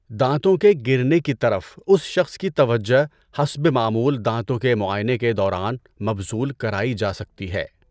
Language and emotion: Urdu, neutral